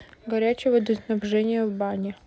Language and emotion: Russian, neutral